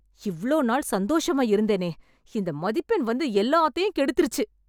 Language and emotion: Tamil, angry